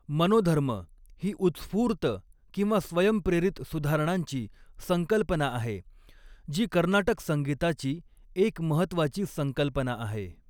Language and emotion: Marathi, neutral